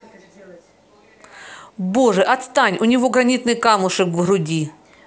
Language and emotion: Russian, angry